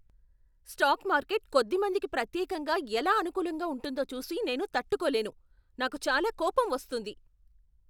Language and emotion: Telugu, angry